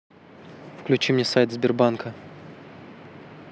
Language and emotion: Russian, neutral